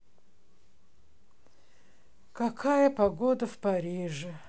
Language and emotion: Russian, sad